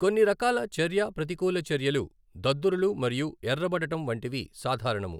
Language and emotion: Telugu, neutral